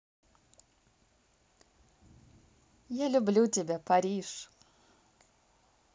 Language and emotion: Russian, positive